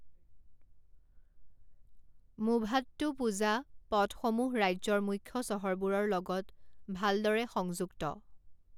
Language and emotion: Assamese, neutral